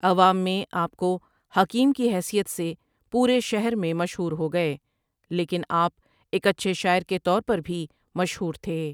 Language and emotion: Urdu, neutral